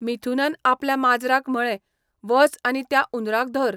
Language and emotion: Goan Konkani, neutral